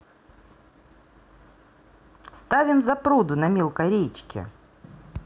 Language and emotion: Russian, neutral